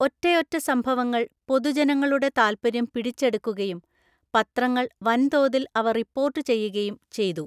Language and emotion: Malayalam, neutral